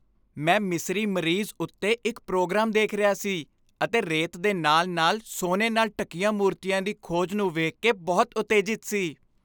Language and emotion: Punjabi, happy